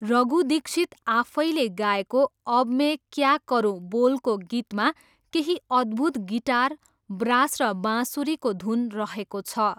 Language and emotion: Nepali, neutral